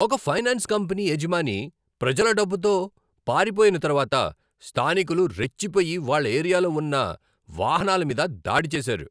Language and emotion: Telugu, angry